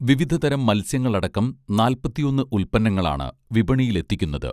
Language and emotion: Malayalam, neutral